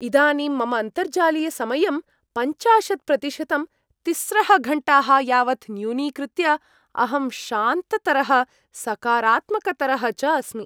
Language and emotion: Sanskrit, happy